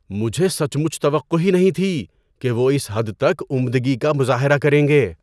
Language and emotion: Urdu, surprised